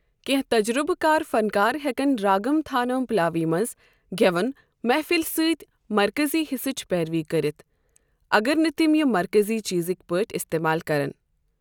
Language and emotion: Kashmiri, neutral